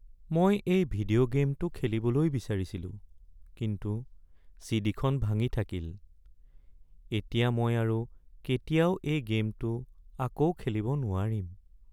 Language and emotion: Assamese, sad